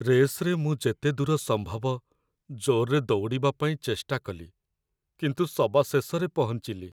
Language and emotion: Odia, sad